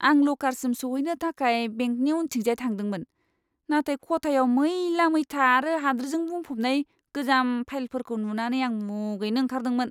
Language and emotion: Bodo, disgusted